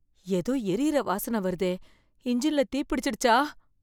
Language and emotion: Tamil, fearful